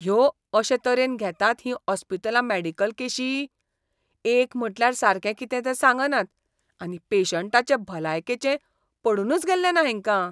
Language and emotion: Goan Konkani, disgusted